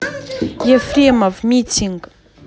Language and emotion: Russian, neutral